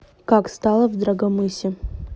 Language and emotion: Russian, neutral